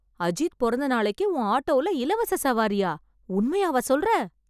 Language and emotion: Tamil, surprised